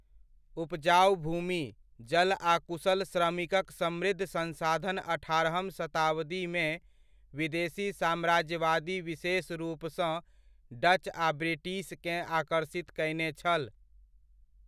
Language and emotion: Maithili, neutral